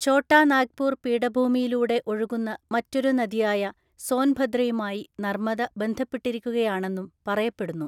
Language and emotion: Malayalam, neutral